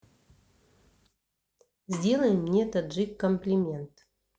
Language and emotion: Russian, neutral